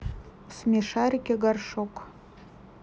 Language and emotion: Russian, neutral